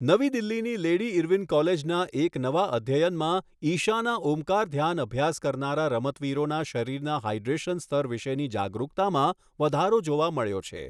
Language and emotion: Gujarati, neutral